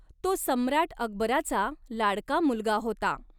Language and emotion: Marathi, neutral